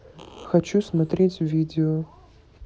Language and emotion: Russian, neutral